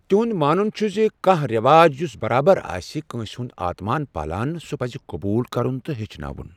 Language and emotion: Kashmiri, neutral